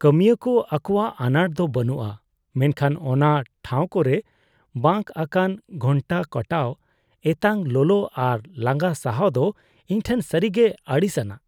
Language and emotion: Santali, disgusted